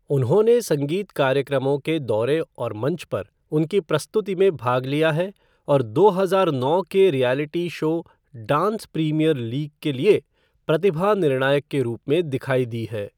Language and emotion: Hindi, neutral